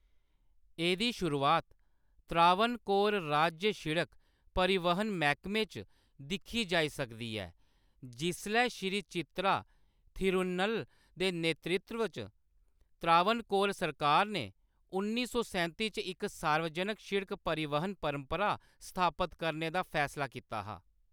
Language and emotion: Dogri, neutral